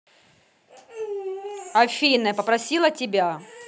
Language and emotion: Russian, angry